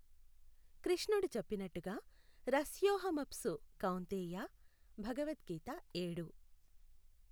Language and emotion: Telugu, neutral